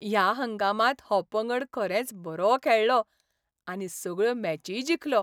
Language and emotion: Goan Konkani, happy